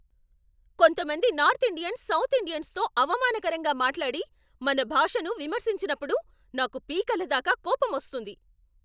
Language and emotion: Telugu, angry